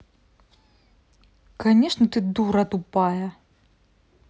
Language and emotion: Russian, angry